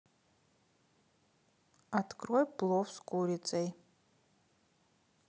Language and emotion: Russian, neutral